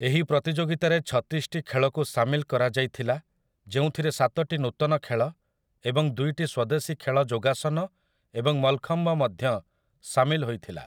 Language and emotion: Odia, neutral